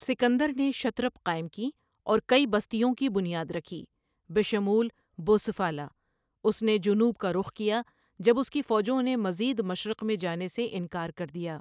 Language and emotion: Urdu, neutral